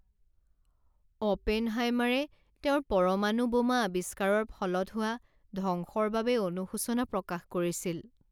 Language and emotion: Assamese, sad